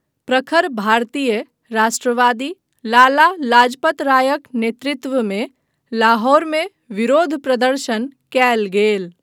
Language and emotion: Maithili, neutral